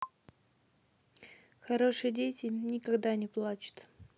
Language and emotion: Russian, neutral